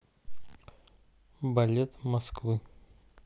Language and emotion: Russian, neutral